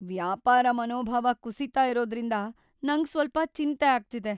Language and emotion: Kannada, fearful